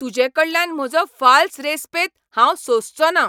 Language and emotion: Goan Konkani, angry